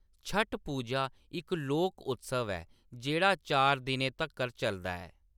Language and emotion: Dogri, neutral